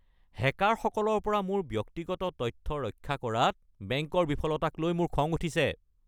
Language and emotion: Assamese, angry